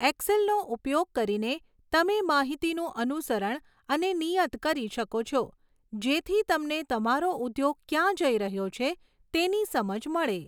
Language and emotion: Gujarati, neutral